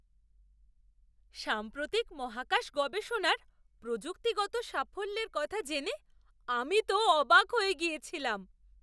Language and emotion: Bengali, surprised